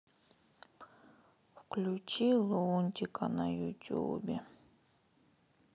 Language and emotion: Russian, sad